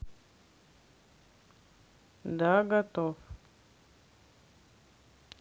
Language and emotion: Russian, neutral